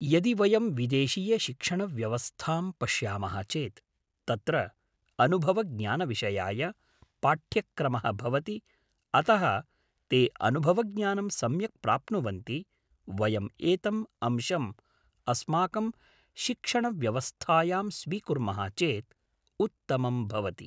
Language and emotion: Sanskrit, neutral